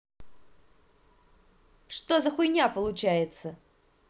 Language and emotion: Russian, angry